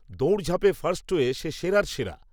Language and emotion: Bengali, neutral